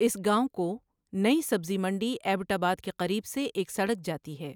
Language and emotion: Urdu, neutral